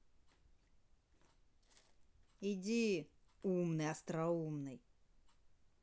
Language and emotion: Russian, angry